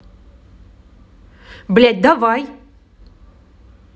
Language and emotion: Russian, angry